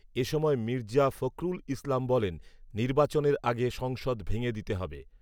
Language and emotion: Bengali, neutral